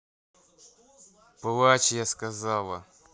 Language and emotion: Russian, angry